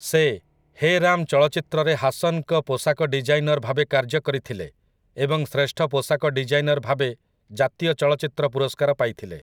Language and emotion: Odia, neutral